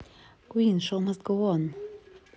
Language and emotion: Russian, neutral